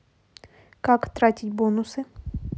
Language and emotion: Russian, neutral